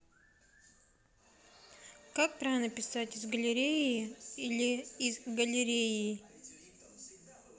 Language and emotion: Russian, neutral